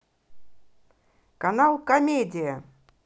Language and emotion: Russian, positive